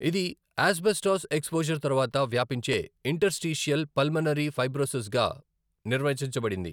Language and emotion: Telugu, neutral